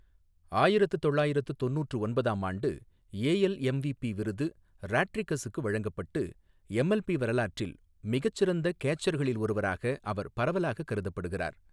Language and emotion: Tamil, neutral